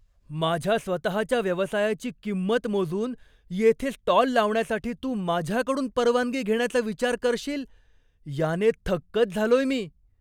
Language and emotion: Marathi, surprised